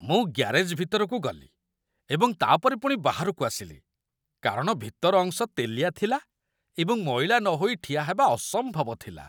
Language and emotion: Odia, disgusted